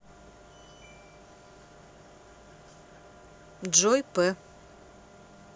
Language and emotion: Russian, neutral